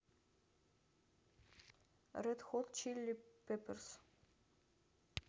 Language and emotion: Russian, neutral